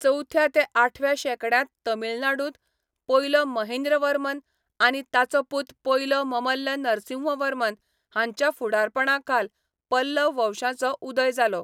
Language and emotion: Goan Konkani, neutral